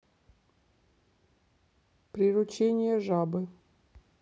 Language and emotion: Russian, neutral